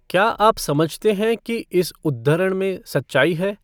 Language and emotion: Hindi, neutral